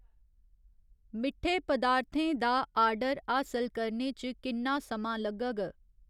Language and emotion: Dogri, neutral